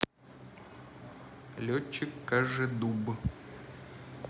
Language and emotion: Russian, neutral